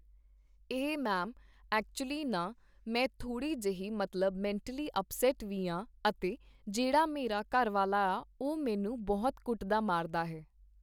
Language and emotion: Punjabi, neutral